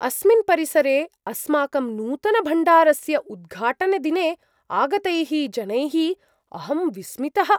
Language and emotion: Sanskrit, surprised